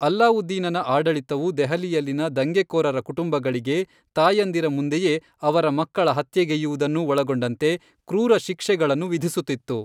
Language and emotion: Kannada, neutral